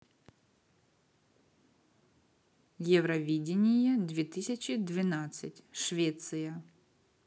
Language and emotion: Russian, neutral